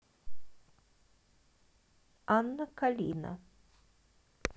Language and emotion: Russian, neutral